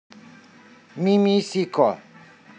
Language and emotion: Russian, neutral